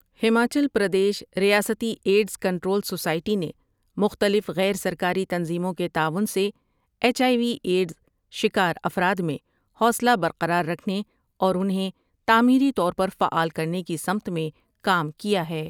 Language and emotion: Urdu, neutral